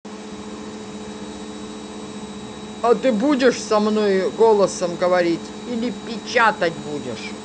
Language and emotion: Russian, angry